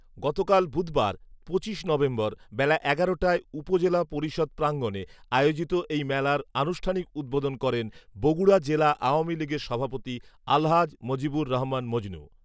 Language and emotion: Bengali, neutral